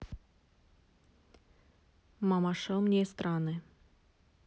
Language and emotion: Russian, neutral